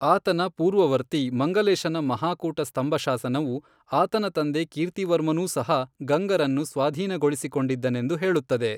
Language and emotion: Kannada, neutral